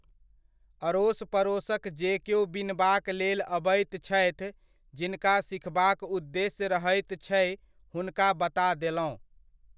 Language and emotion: Maithili, neutral